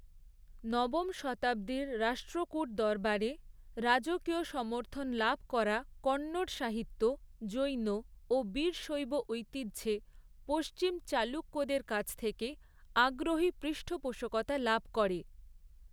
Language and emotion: Bengali, neutral